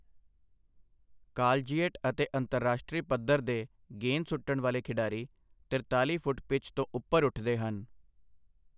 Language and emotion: Punjabi, neutral